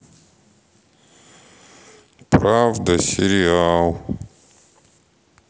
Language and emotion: Russian, sad